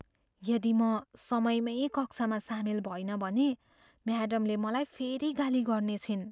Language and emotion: Nepali, fearful